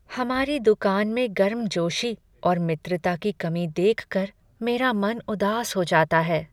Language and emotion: Hindi, sad